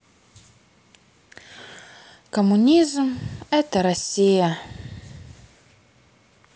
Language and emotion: Russian, sad